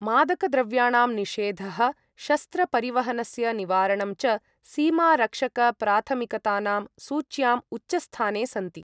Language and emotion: Sanskrit, neutral